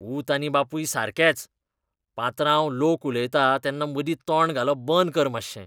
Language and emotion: Goan Konkani, disgusted